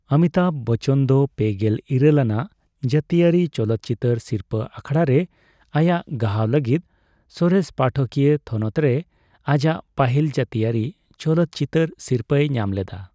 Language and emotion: Santali, neutral